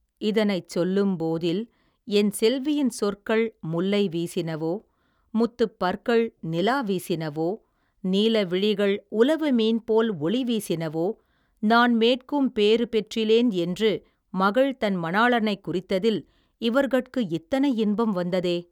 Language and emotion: Tamil, neutral